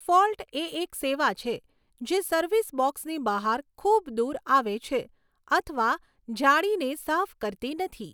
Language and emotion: Gujarati, neutral